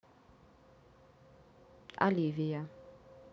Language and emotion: Russian, neutral